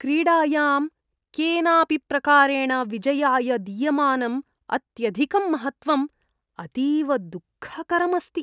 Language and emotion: Sanskrit, disgusted